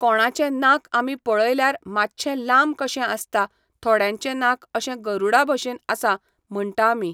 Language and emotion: Goan Konkani, neutral